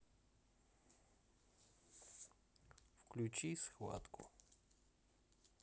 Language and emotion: Russian, neutral